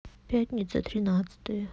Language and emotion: Russian, sad